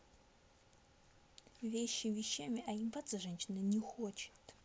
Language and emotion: Russian, angry